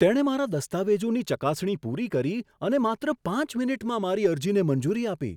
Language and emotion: Gujarati, surprised